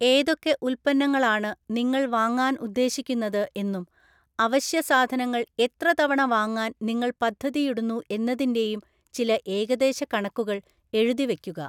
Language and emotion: Malayalam, neutral